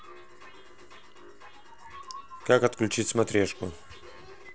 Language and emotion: Russian, neutral